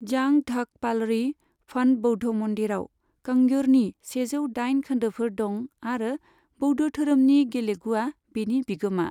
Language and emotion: Bodo, neutral